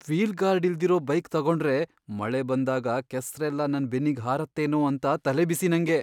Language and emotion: Kannada, fearful